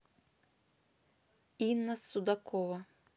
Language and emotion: Russian, neutral